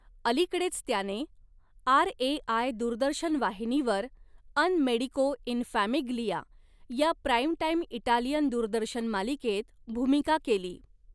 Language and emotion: Marathi, neutral